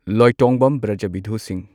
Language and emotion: Manipuri, neutral